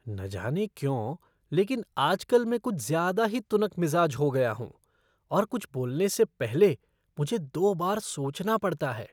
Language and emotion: Hindi, disgusted